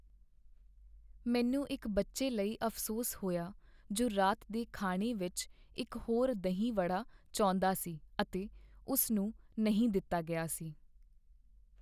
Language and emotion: Punjabi, sad